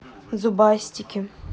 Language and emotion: Russian, neutral